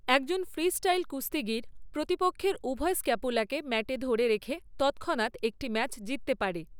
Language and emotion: Bengali, neutral